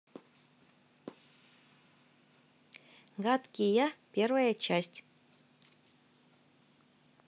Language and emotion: Russian, positive